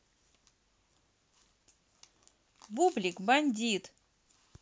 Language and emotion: Russian, positive